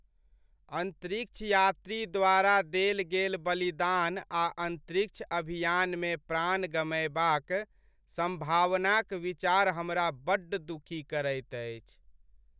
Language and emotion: Maithili, sad